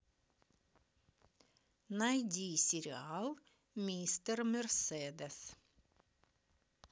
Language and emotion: Russian, positive